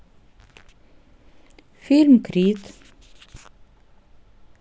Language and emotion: Russian, neutral